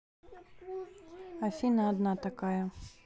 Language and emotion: Russian, neutral